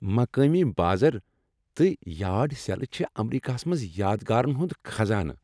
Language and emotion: Kashmiri, happy